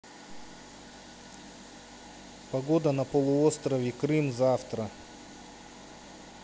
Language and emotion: Russian, neutral